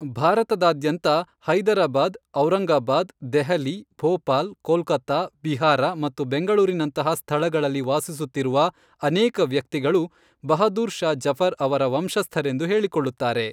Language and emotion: Kannada, neutral